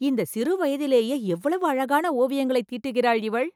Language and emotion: Tamil, surprised